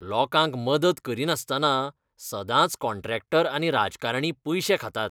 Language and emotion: Goan Konkani, disgusted